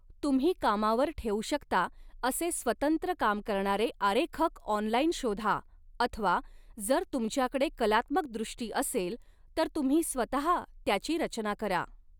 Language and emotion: Marathi, neutral